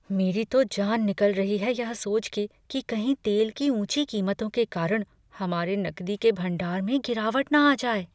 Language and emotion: Hindi, fearful